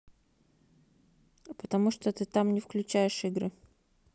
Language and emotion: Russian, neutral